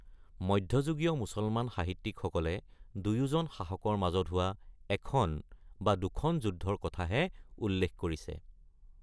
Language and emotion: Assamese, neutral